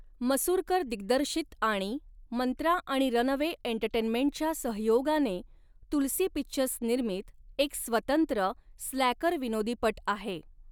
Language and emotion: Marathi, neutral